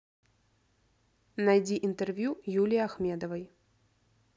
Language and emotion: Russian, neutral